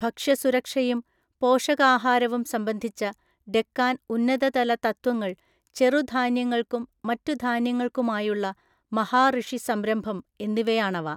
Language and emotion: Malayalam, neutral